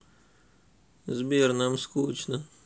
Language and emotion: Russian, sad